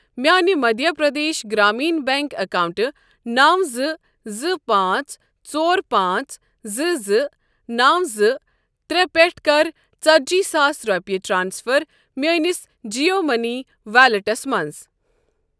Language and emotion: Kashmiri, neutral